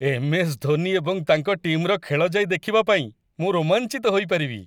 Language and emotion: Odia, happy